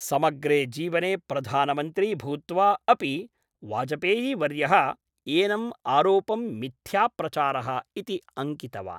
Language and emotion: Sanskrit, neutral